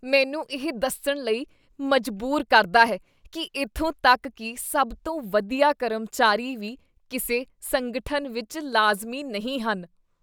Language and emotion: Punjabi, disgusted